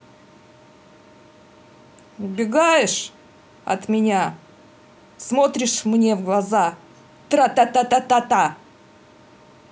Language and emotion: Russian, angry